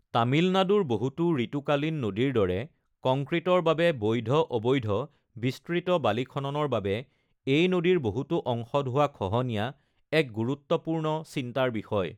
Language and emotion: Assamese, neutral